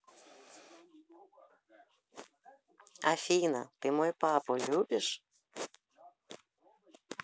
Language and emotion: Russian, positive